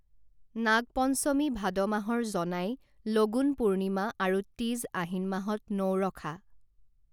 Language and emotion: Assamese, neutral